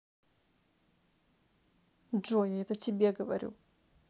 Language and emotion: Russian, neutral